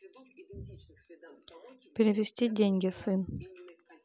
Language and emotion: Russian, neutral